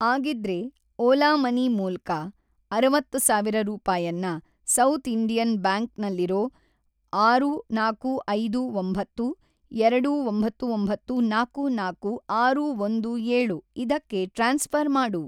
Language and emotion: Kannada, neutral